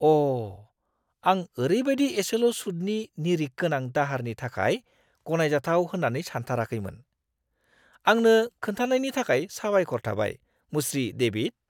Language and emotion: Bodo, surprised